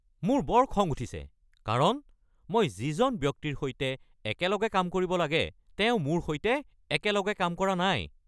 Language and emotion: Assamese, angry